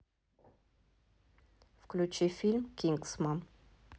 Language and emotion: Russian, neutral